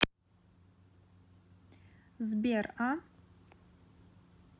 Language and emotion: Russian, neutral